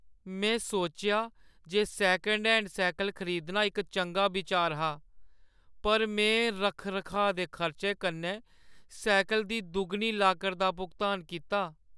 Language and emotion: Dogri, sad